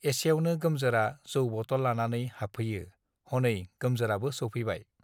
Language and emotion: Bodo, neutral